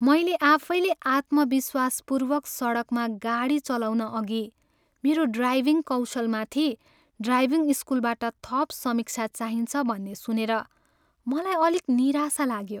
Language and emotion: Nepali, sad